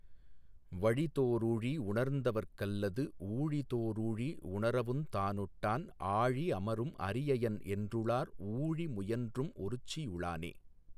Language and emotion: Tamil, neutral